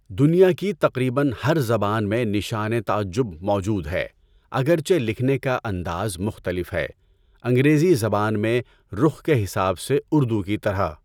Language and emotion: Urdu, neutral